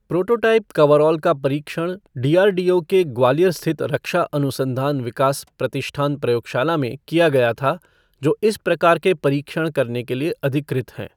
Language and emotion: Hindi, neutral